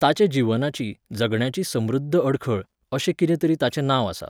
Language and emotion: Goan Konkani, neutral